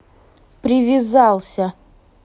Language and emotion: Russian, angry